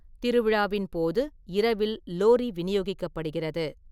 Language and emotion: Tamil, neutral